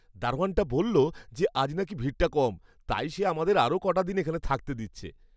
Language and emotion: Bengali, happy